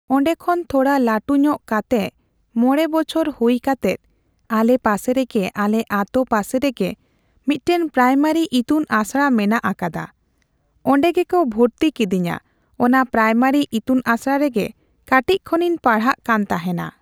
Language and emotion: Santali, neutral